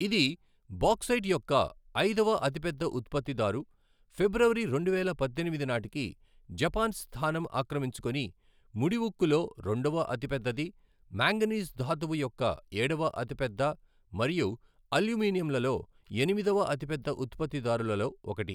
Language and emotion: Telugu, neutral